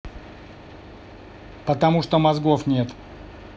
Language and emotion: Russian, angry